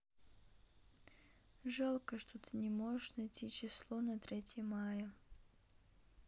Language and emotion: Russian, sad